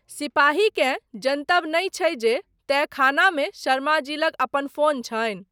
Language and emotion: Maithili, neutral